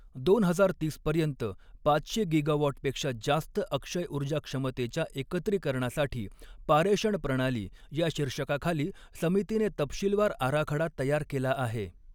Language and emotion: Marathi, neutral